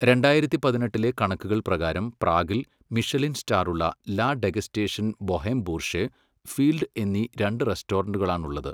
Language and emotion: Malayalam, neutral